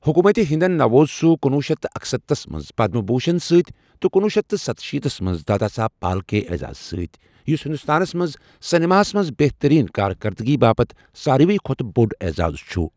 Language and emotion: Kashmiri, neutral